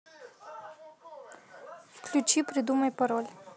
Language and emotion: Russian, neutral